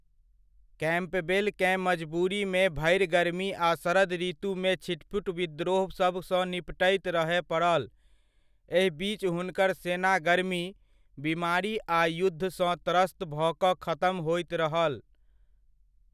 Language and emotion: Maithili, neutral